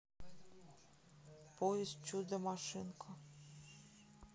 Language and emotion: Russian, sad